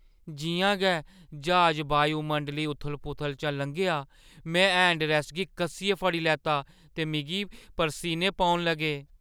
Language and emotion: Dogri, fearful